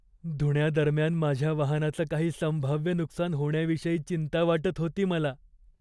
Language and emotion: Marathi, fearful